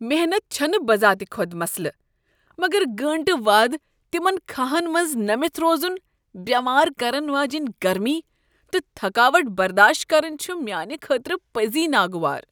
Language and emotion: Kashmiri, disgusted